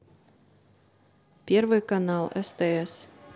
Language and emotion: Russian, neutral